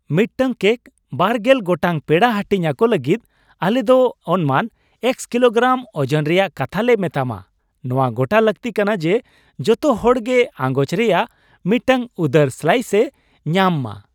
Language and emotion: Santali, happy